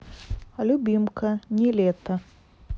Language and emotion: Russian, neutral